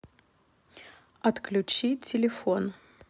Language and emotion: Russian, neutral